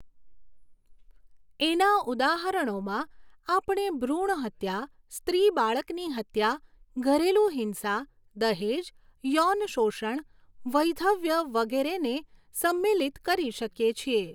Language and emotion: Gujarati, neutral